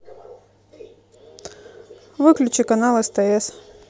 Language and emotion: Russian, neutral